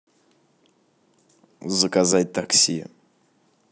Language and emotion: Russian, neutral